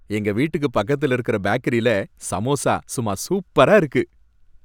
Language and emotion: Tamil, happy